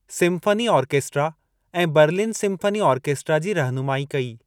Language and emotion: Sindhi, neutral